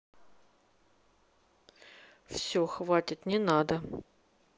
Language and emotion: Russian, neutral